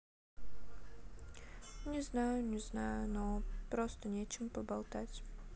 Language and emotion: Russian, sad